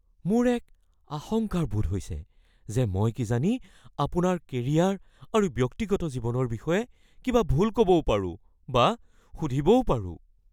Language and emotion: Assamese, fearful